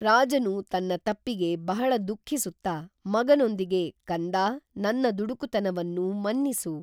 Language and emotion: Kannada, neutral